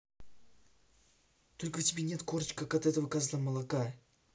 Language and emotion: Russian, angry